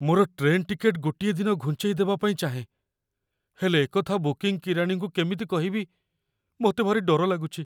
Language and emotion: Odia, fearful